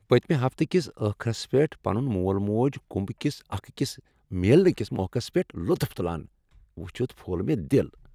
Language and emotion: Kashmiri, happy